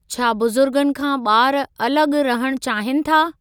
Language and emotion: Sindhi, neutral